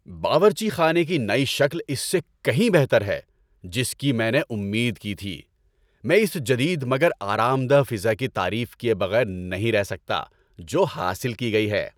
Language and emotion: Urdu, happy